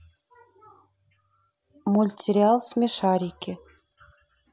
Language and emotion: Russian, neutral